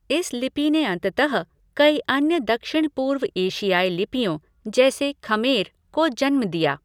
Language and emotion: Hindi, neutral